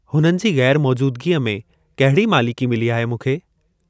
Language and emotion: Sindhi, neutral